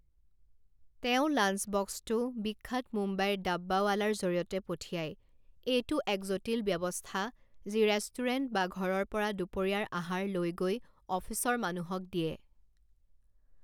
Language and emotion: Assamese, neutral